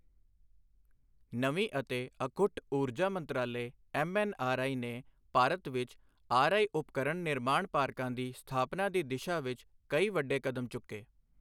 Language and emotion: Punjabi, neutral